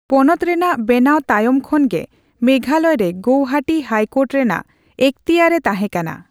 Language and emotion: Santali, neutral